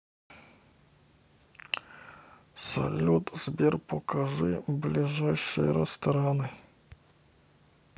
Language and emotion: Russian, neutral